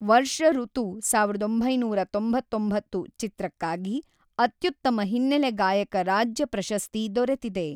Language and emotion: Kannada, neutral